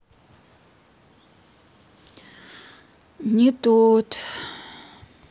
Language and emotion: Russian, sad